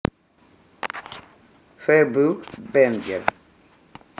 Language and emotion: Russian, neutral